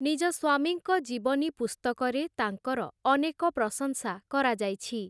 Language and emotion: Odia, neutral